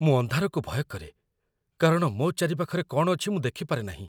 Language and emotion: Odia, fearful